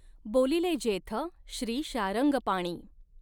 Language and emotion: Marathi, neutral